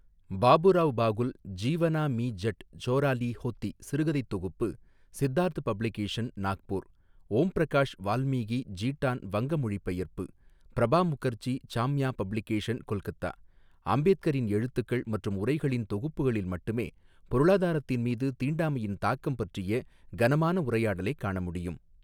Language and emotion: Tamil, neutral